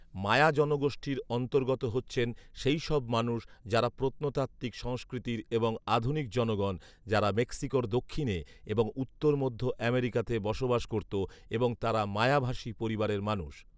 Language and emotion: Bengali, neutral